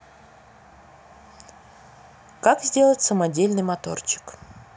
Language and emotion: Russian, neutral